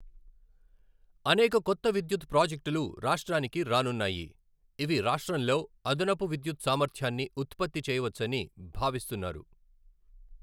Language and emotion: Telugu, neutral